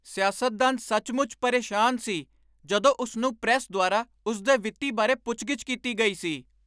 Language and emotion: Punjabi, angry